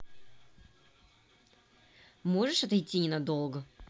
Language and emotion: Russian, angry